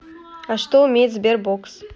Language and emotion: Russian, neutral